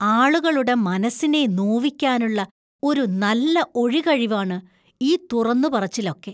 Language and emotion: Malayalam, disgusted